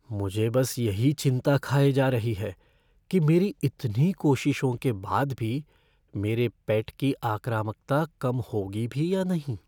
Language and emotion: Hindi, fearful